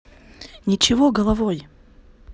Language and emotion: Russian, neutral